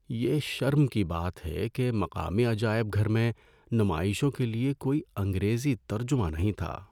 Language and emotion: Urdu, sad